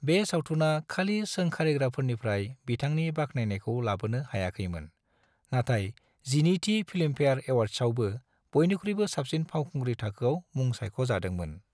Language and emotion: Bodo, neutral